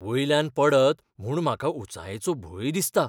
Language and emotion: Goan Konkani, fearful